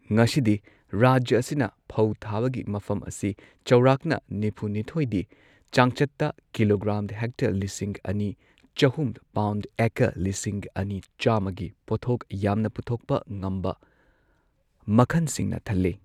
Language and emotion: Manipuri, neutral